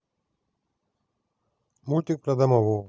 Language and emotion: Russian, neutral